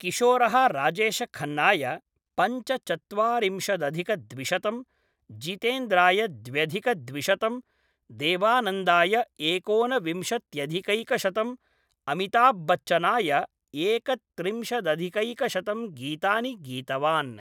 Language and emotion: Sanskrit, neutral